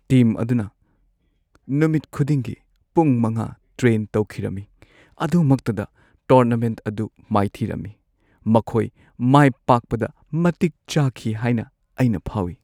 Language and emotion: Manipuri, sad